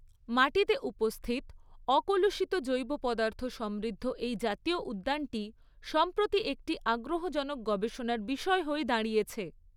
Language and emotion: Bengali, neutral